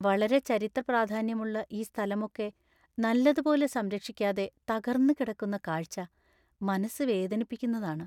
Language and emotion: Malayalam, sad